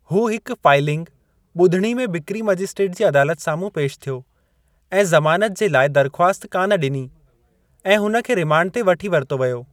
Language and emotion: Sindhi, neutral